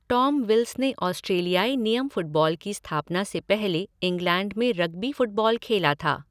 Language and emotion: Hindi, neutral